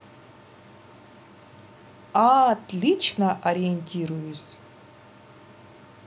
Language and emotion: Russian, positive